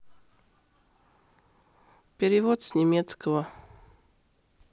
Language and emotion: Russian, neutral